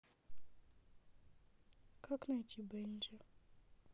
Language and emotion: Russian, sad